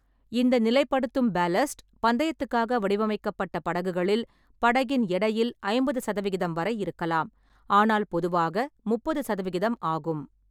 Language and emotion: Tamil, neutral